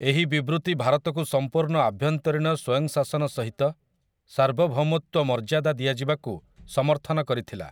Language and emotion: Odia, neutral